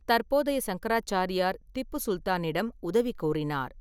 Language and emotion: Tamil, neutral